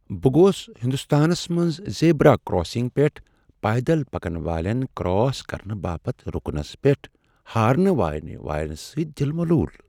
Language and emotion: Kashmiri, sad